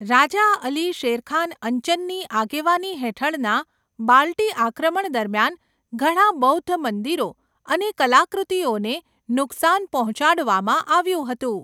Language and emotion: Gujarati, neutral